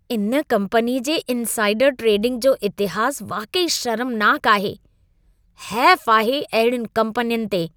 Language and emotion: Sindhi, disgusted